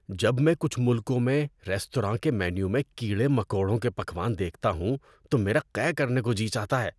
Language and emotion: Urdu, disgusted